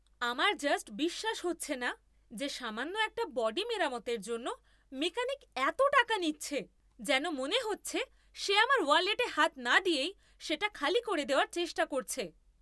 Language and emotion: Bengali, angry